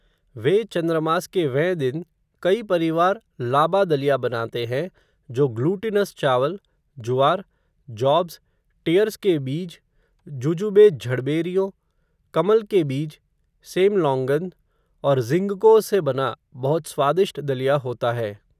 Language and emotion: Hindi, neutral